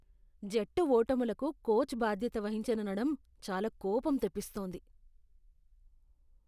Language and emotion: Telugu, disgusted